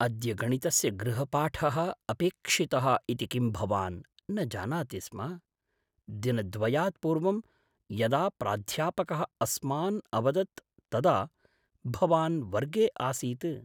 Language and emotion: Sanskrit, surprised